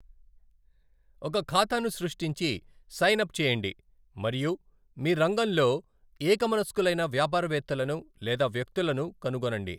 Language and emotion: Telugu, neutral